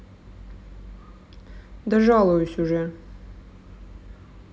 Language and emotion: Russian, sad